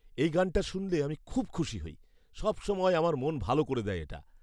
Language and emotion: Bengali, happy